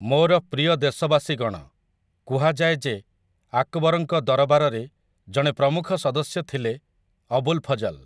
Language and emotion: Odia, neutral